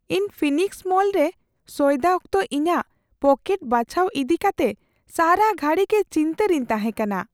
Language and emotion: Santali, fearful